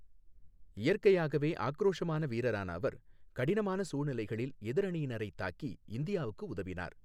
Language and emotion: Tamil, neutral